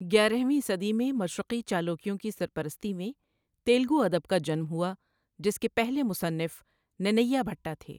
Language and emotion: Urdu, neutral